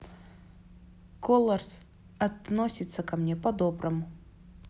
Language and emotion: Russian, neutral